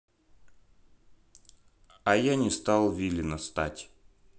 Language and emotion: Russian, neutral